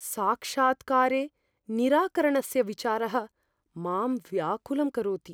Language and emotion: Sanskrit, fearful